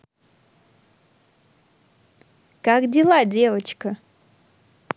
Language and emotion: Russian, positive